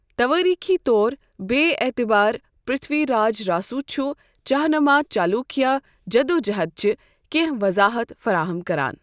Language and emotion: Kashmiri, neutral